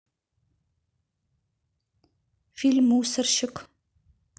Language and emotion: Russian, neutral